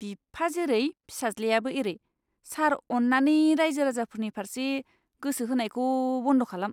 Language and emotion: Bodo, disgusted